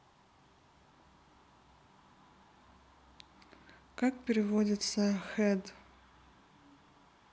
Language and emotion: Russian, neutral